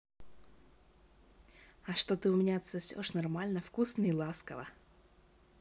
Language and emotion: Russian, positive